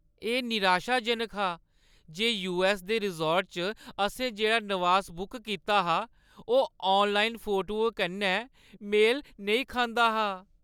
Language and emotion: Dogri, sad